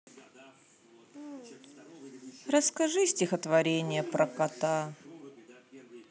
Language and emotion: Russian, sad